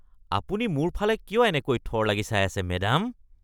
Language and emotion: Assamese, disgusted